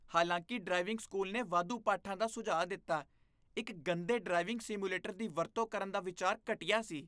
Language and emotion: Punjabi, disgusted